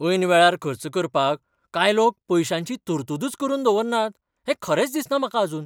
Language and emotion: Goan Konkani, surprised